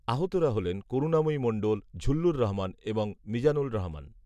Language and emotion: Bengali, neutral